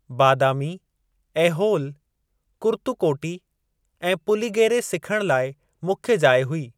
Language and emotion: Sindhi, neutral